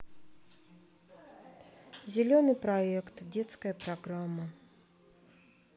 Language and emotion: Russian, sad